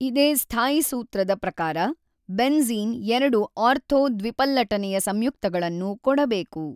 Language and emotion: Kannada, neutral